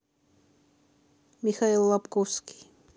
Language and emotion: Russian, neutral